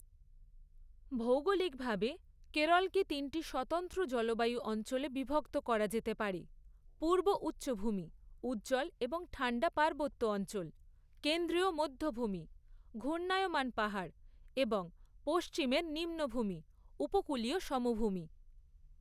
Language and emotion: Bengali, neutral